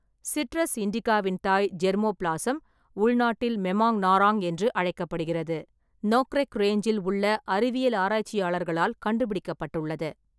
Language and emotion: Tamil, neutral